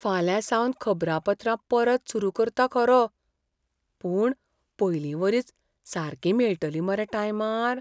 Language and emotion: Goan Konkani, fearful